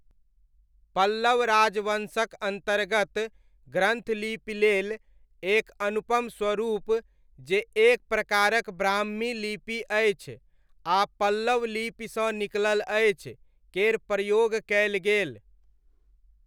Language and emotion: Maithili, neutral